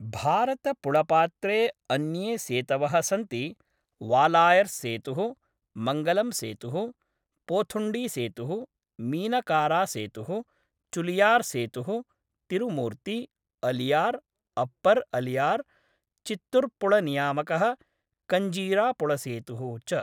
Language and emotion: Sanskrit, neutral